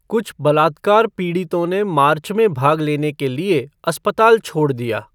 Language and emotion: Hindi, neutral